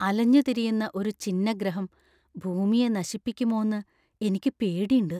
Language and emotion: Malayalam, fearful